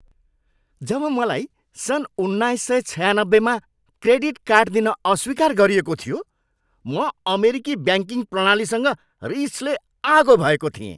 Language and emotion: Nepali, angry